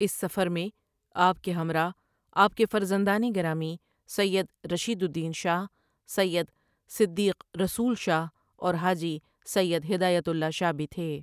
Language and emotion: Urdu, neutral